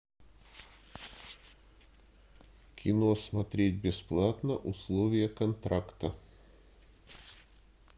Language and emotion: Russian, neutral